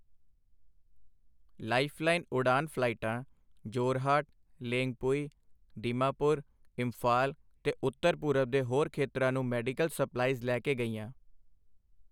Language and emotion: Punjabi, neutral